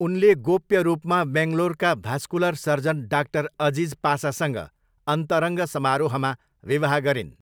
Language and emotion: Nepali, neutral